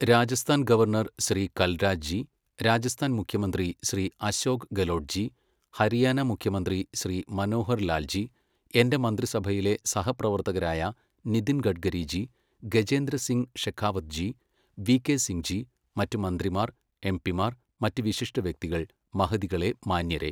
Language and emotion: Malayalam, neutral